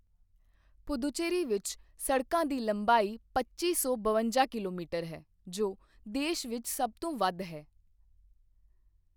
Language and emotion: Punjabi, neutral